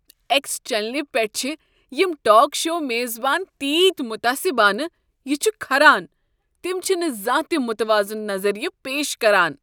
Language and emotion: Kashmiri, disgusted